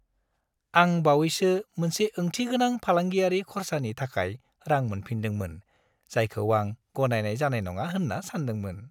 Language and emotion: Bodo, happy